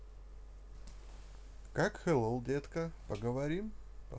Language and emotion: Russian, positive